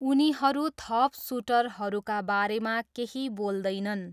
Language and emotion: Nepali, neutral